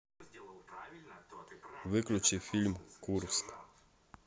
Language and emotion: Russian, neutral